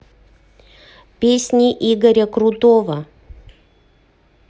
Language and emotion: Russian, neutral